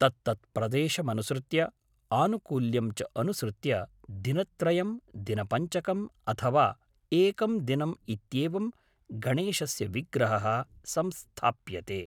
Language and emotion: Sanskrit, neutral